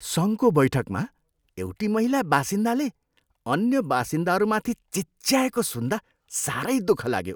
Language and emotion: Nepali, disgusted